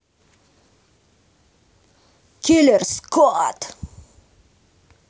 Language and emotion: Russian, angry